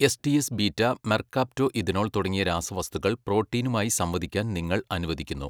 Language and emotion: Malayalam, neutral